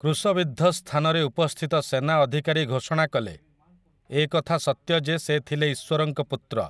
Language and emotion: Odia, neutral